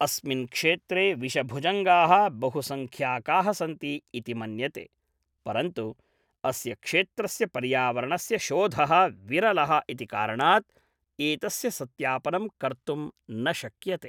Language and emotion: Sanskrit, neutral